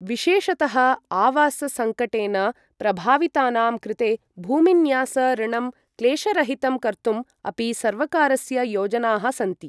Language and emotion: Sanskrit, neutral